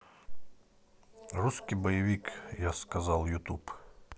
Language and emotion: Russian, neutral